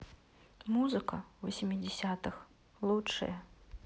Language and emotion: Russian, neutral